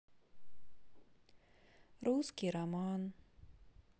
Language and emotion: Russian, sad